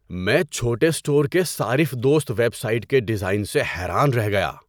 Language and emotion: Urdu, surprised